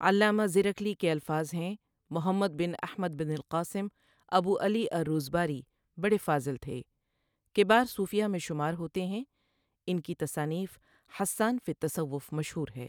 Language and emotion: Urdu, neutral